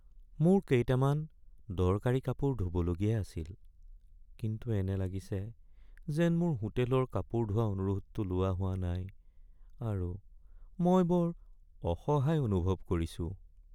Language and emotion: Assamese, sad